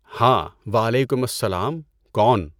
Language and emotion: Urdu, neutral